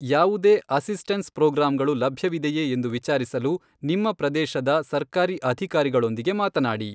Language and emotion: Kannada, neutral